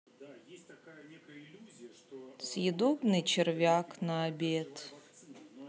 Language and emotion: Russian, neutral